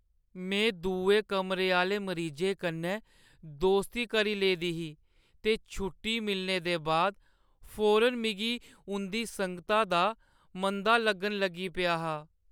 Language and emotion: Dogri, sad